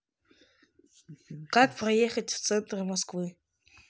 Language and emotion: Russian, neutral